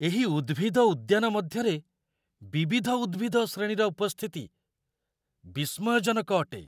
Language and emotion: Odia, surprised